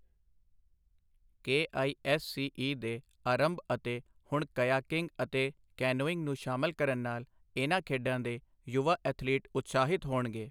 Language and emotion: Punjabi, neutral